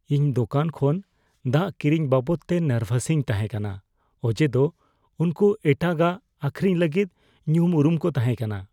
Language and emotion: Santali, fearful